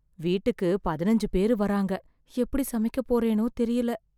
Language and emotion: Tamil, fearful